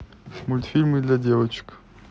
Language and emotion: Russian, neutral